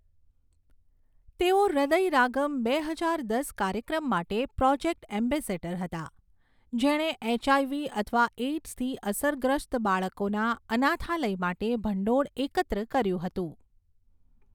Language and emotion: Gujarati, neutral